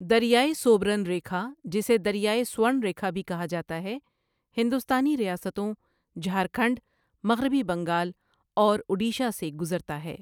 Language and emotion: Urdu, neutral